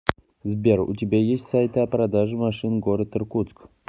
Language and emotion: Russian, neutral